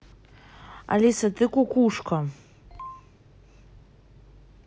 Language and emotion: Russian, angry